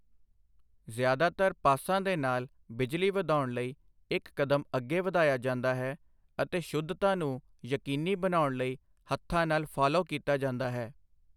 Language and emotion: Punjabi, neutral